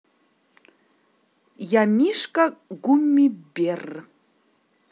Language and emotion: Russian, positive